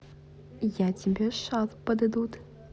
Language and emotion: Russian, positive